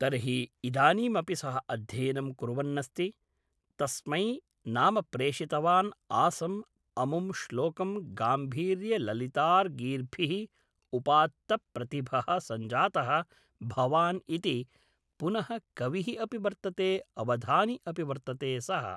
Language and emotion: Sanskrit, neutral